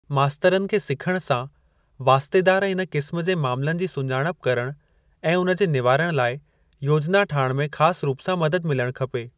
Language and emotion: Sindhi, neutral